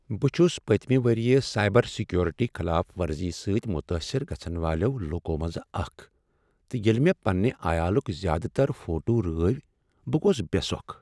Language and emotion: Kashmiri, sad